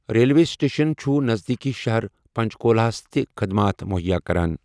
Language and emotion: Kashmiri, neutral